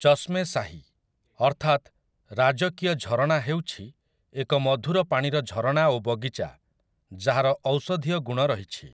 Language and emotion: Odia, neutral